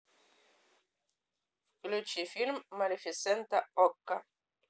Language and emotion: Russian, neutral